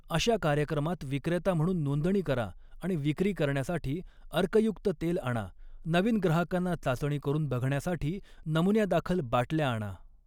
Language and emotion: Marathi, neutral